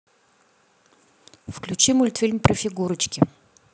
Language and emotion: Russian, neutral